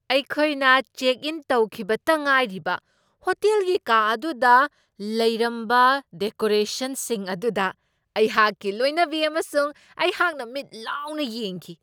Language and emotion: Manipuri, surprised